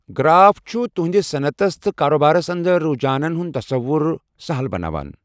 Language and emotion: Kashmiri, neutral